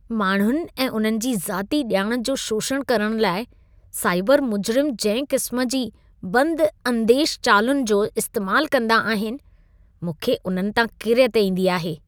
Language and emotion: Sindhi, disgusted